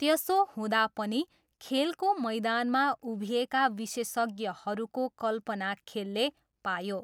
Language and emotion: Nepali, neutral